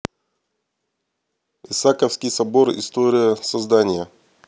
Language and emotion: Russian, neutral